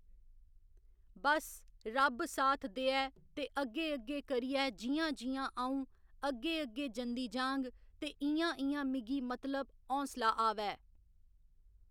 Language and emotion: Dogri, neutral